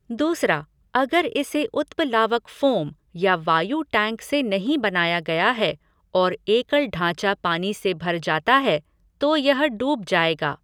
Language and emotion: Hindi, neutral